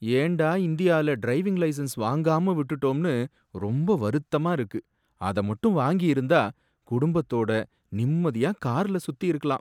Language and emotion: Tamil, sad